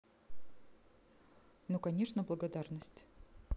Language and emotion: Russian, neutral